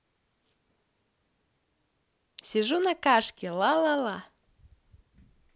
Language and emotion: Russian, positive